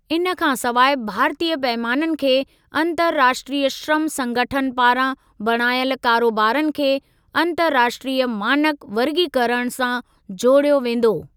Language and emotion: Sindhi, neutral